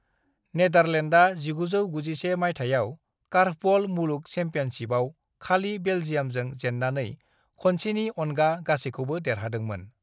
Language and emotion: Bodo, neutral